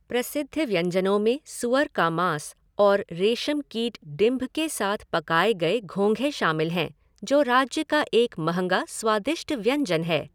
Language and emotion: Hindi, neutral